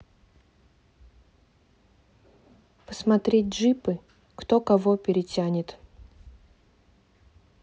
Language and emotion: Russian, neutral